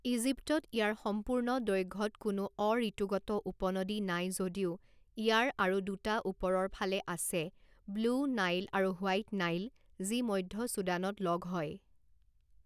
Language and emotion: Assamese, neutral